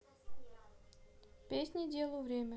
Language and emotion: Russian, neutral